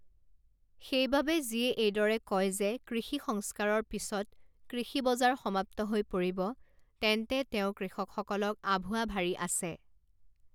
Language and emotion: Assamese, neutral